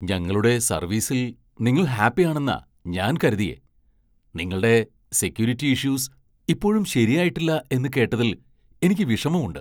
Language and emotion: Malayalam, surprised